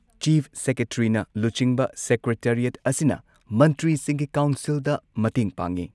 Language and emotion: Manipuri, neutral